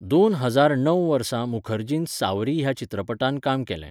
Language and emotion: Goan Konkani, neutral